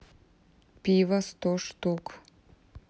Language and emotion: Russian, neutral